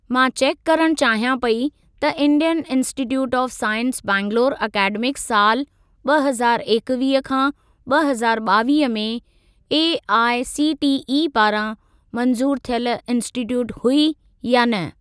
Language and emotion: Sindhi, neutral